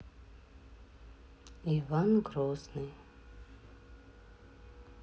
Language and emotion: Russian, neutral